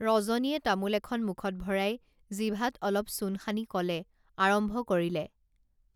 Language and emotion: Assamese, neutral